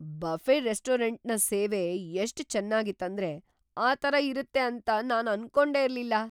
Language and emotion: Kannada, surprised